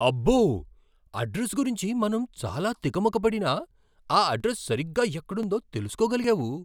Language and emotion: Telugu, surprised